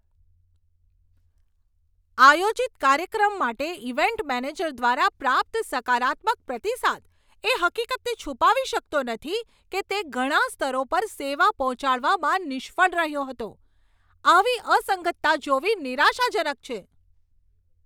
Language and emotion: Gujarati, angry